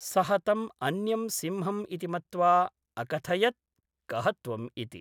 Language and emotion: Sanskrit, neutral